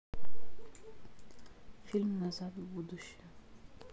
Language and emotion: Russian, neutral